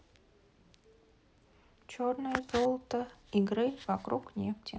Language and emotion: Russian, sad